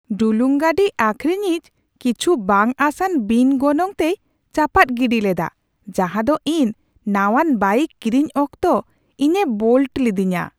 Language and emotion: Santali, surprised